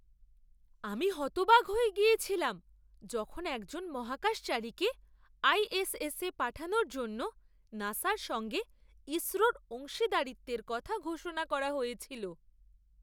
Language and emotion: Bengali, surprised